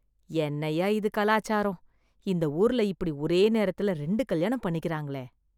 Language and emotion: Tamil, disgusted